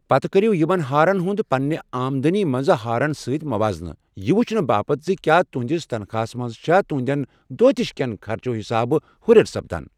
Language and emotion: Kashmiri, neutral